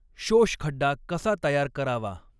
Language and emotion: Marathi, neutral